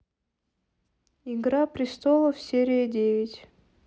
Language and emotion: Russian, neutral